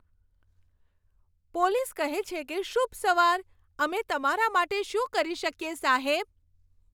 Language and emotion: Gujarati, happy